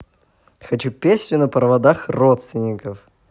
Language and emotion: Russian, positive